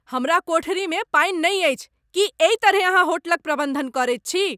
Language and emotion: Maithili, angry